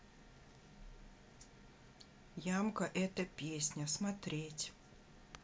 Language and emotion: Russian, neutral